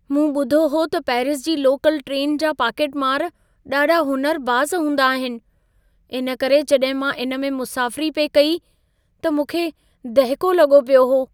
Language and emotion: Sindhi, fearful